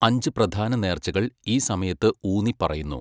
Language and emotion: Malayalam, neutral